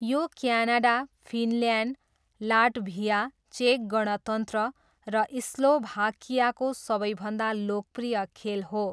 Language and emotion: Nepali, neutral